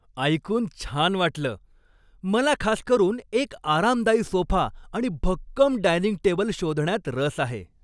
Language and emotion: Marathi, happy